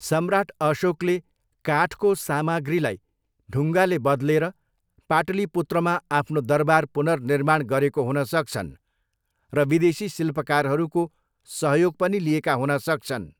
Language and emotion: Nepali, neutral